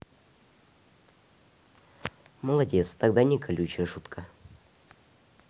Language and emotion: Russian, neutral